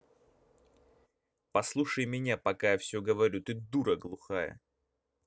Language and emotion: Russian, angry